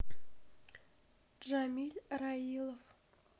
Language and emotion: Russian, sad